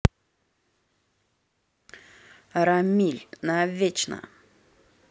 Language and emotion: Russian, neutral